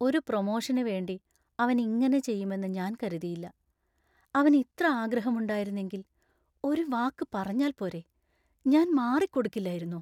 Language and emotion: Malayalam, sad